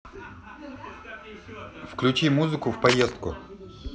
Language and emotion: Russian, neutral